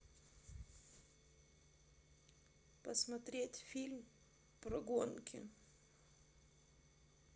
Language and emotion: Russian, sad